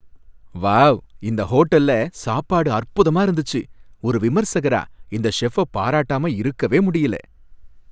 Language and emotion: Tamil, happy